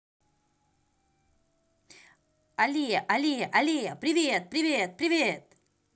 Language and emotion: Russian, positive